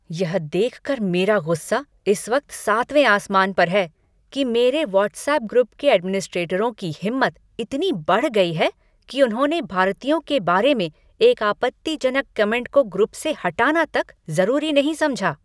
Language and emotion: Hindi, angry